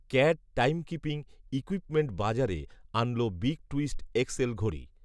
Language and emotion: Bengali, neutral